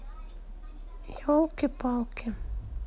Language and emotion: Russian, sad